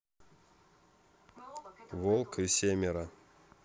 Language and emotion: Russian, neutral